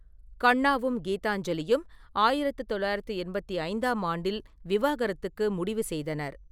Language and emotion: Tamil, neutral